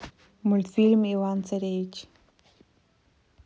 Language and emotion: Russian, neutral